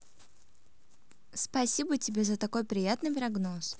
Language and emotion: Russian, positive